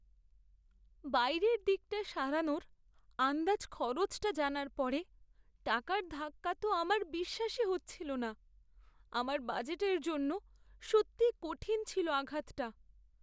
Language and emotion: Bengali, sad